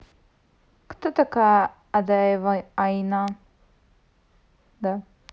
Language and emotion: Russian, neutral